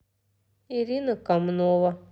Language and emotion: Russian, neutral